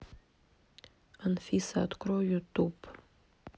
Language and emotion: Russian, neutral